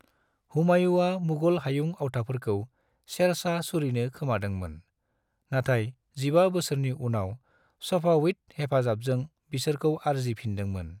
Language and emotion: Bodo, neutral